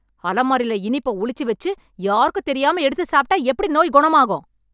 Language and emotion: Tamil, angry